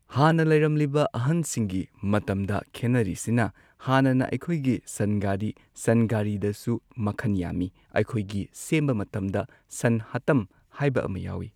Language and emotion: Manipuri, neutral